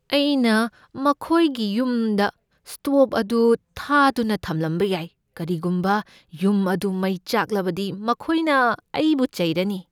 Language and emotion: Manipuri, fearful